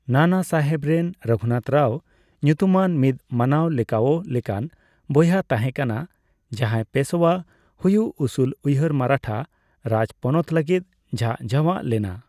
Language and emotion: Santali, neutral